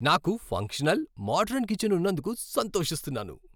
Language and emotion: Telugu, happy